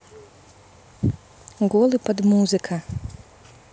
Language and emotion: Russian, neutral